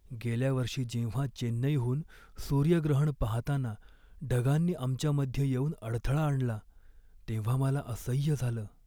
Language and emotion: Marathi, sad